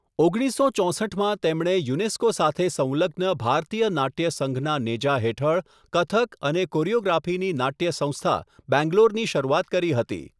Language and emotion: Gujarati, neutral